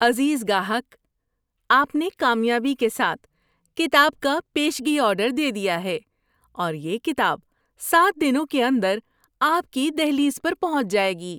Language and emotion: Urdu, happy